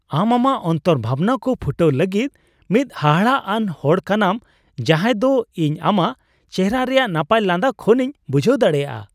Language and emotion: Santali, happy